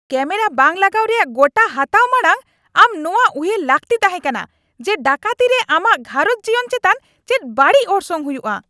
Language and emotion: Santali, angry